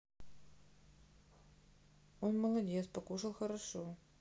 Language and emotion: Russian, neutral